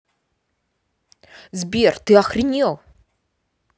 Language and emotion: Russian, angry